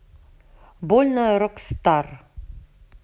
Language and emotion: Russian, neutral